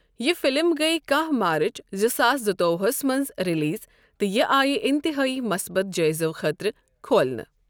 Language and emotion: Kashmiri, neutral